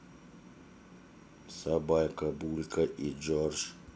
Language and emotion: Russian, neutral